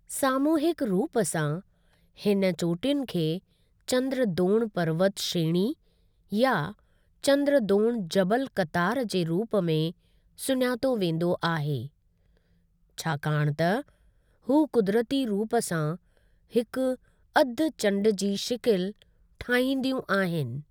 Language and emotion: Sindhi, neutral